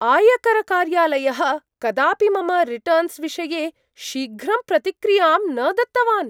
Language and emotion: Sanskrit, surprised